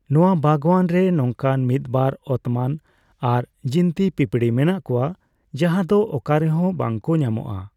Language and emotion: Santali, neutral